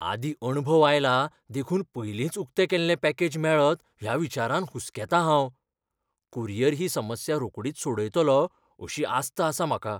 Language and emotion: Goan Konkani, fearful